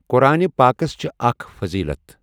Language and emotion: Kashmiri, neutral